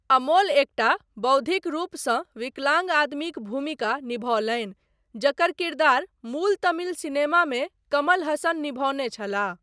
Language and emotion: Maithili, neutral